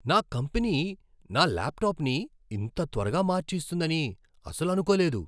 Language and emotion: Telugu, surprised